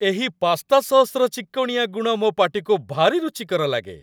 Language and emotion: Odia, happy